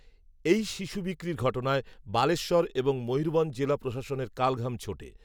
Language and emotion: Bengali, neutral